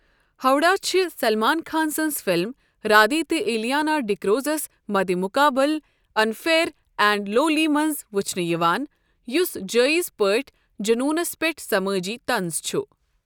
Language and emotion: Kashmiri, neutral